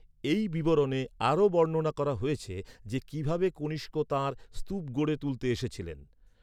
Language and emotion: Bengali, neutral